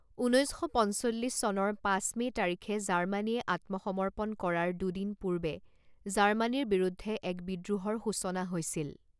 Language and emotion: Assamese, neutral